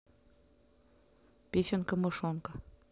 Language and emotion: Russian, neutral